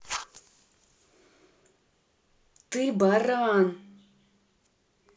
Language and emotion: Russian, angry